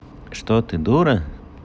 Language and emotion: Russian, neutral